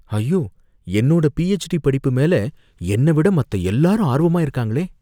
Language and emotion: Tamil, fearful